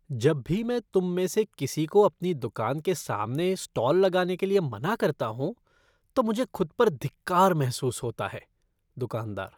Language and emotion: Hindi, disgusted